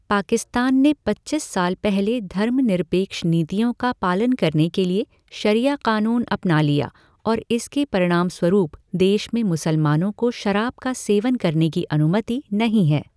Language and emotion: Hindi, neutral